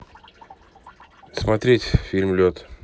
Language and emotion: Russian, neutral